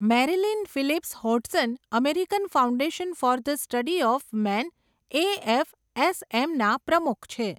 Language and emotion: Gujarati, neutral